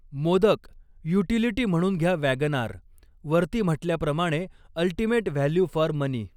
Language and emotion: Marathi, neutral